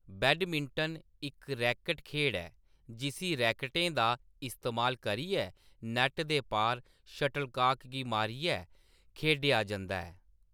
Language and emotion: Dogri, neutral